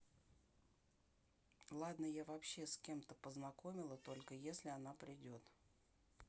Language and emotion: Russian, neutral